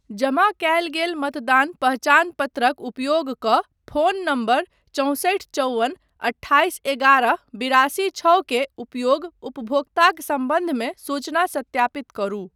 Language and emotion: Maithili, neutral